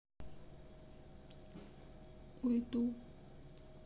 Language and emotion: Russian, sad